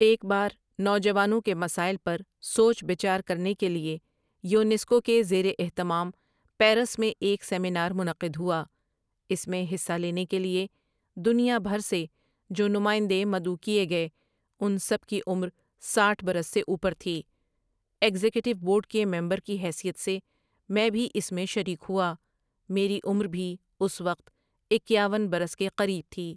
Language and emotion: Urdu, neutral